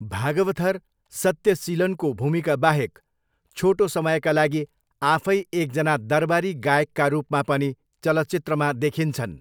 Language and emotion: Nepali, neutral